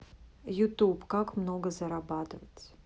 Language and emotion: Russian, neutral